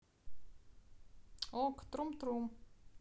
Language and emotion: Russian, neutral